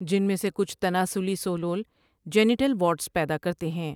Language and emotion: Urdu, neutral